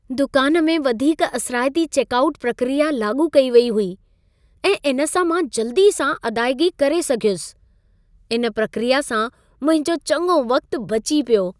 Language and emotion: Sindhi, happy